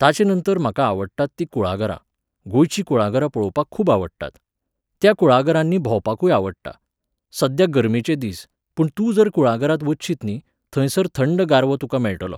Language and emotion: Goan Konkani, neutral